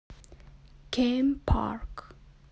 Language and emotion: Russian, neutral